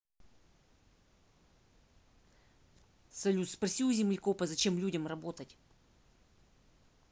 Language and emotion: Russian, neutral